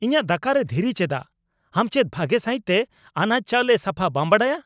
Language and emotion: Santali, angry